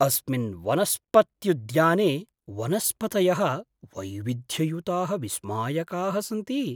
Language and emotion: Sanskrit, surprised